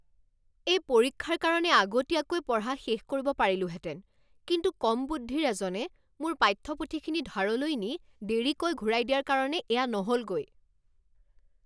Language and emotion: Assamese, angry